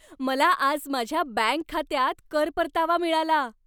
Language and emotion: Marathi, happy